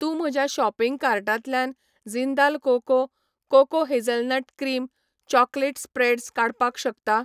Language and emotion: Goan Konkani, neutral